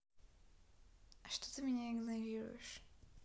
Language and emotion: Russian, sad